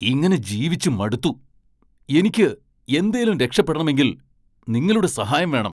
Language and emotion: Malayalam, angry